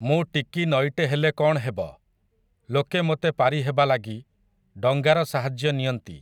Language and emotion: Odia, neutral